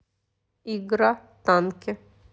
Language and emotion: Russian, neutral